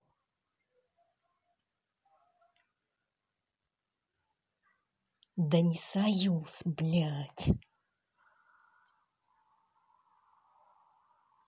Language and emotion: Russian, angry